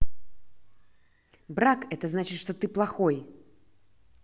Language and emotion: Russian, angry